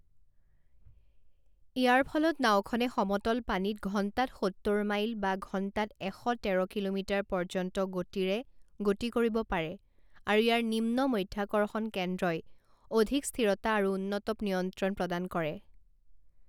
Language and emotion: Assamese, neutral